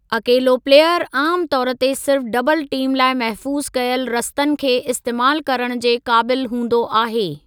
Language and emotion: Sindhi, neutral